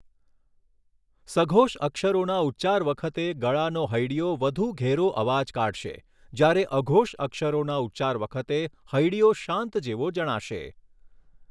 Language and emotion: Gujarati, neutral